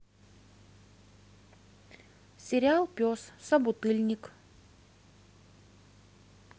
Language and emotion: Russian, neutral